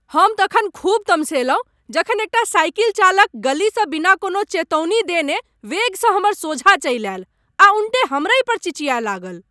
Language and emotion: Maithili, angry